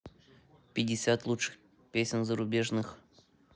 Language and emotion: Russian, neutral